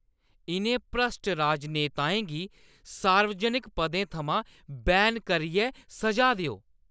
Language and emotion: Dogri, angry